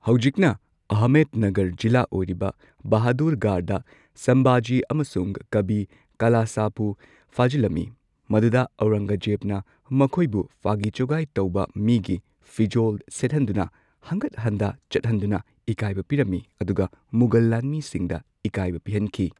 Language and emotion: Manipuri, neutral